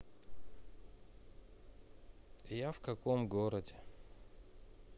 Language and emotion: Russian, sad